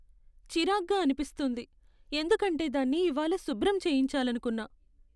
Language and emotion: Telugu, sad